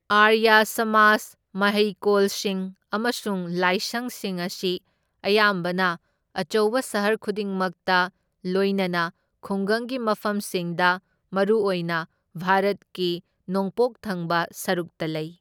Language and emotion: Manipuri, neutral